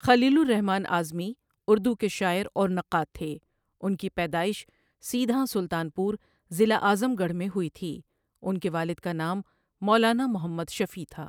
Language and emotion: Urdu, neutral